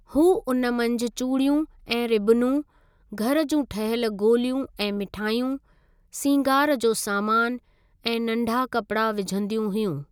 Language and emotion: Sindhi, neutral